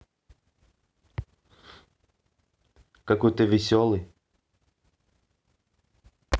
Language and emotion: Russian, neutral